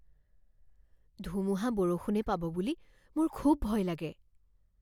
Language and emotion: Assamese, fearful